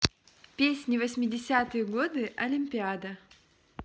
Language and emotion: Russian, positive